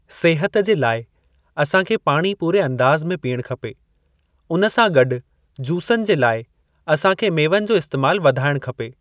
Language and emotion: Sindhi, neutral